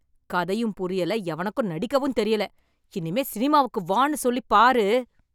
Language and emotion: Tamil, angry